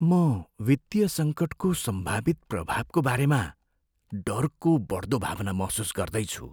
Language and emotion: Nepali, fearful